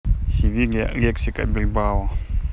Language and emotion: Russian, neutral